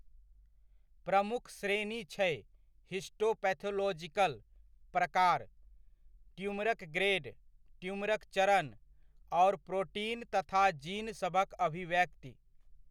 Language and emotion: Maithili, neutral